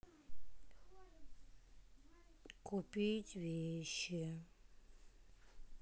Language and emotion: Russian, sad